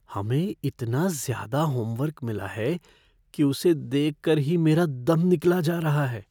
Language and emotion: Hindi, fearful